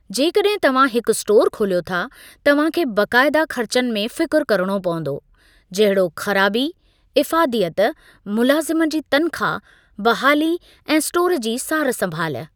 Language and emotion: Sindhi, neutral